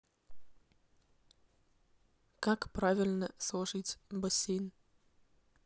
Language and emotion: Russian, neutral